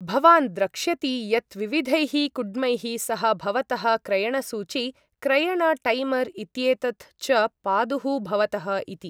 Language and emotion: Sanskrit, neutral